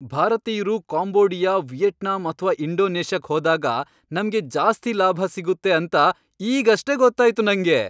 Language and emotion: Kannada, happy